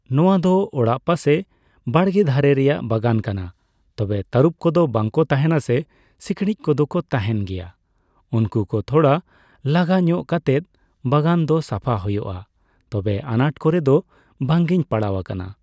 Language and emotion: Santali, neutral